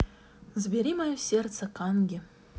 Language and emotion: Russian, neutral